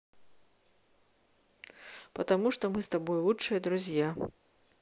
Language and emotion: Russian, neutral